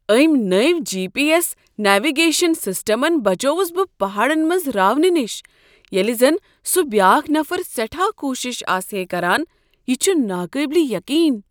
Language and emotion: Kashmiri, surprised